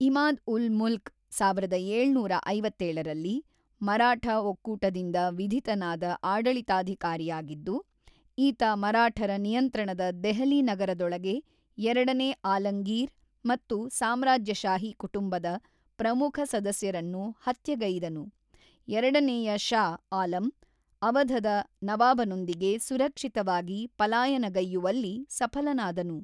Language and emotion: Kannada, neutral